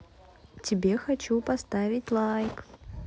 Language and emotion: Russian, positive